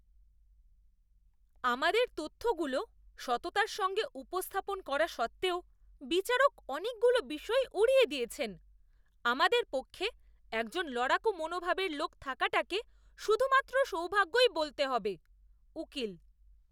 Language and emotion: Bengali, disgusted